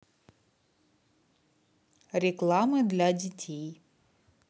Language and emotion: Russian, neutral